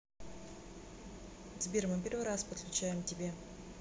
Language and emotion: Russian, neutral